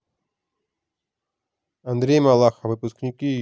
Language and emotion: Russian, neutral